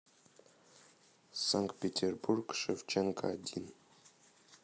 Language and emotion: Russian, neutral